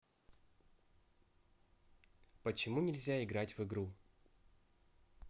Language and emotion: Russian, neutral